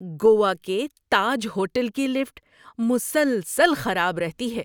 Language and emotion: Urdu, disgusted